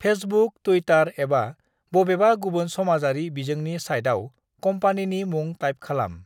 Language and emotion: Bodo, neutral